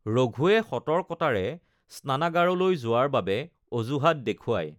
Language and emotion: Assamese, neutral